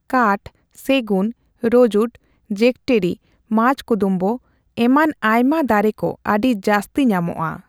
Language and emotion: Santali, neutral